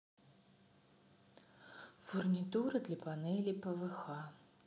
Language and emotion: Russian, neutral